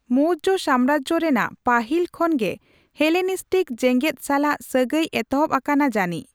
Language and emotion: Santali, neutral